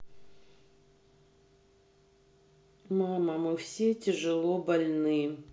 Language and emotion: Russian, sad